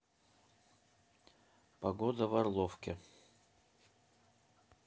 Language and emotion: Russian, neutral